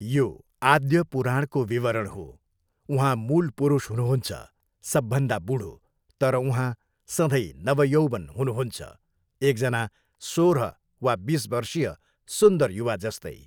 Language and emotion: Nepali, neutral